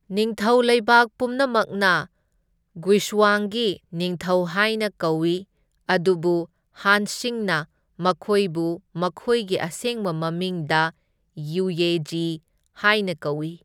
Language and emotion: Manipuri, neutral